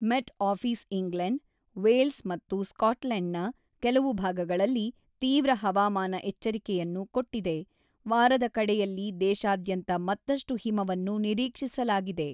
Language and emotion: Kannada, neutral